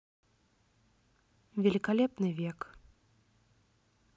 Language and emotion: Russian, neutral